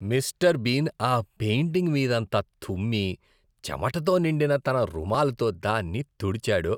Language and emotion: Telugu, disgusted